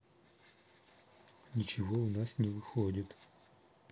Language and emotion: Russian, sad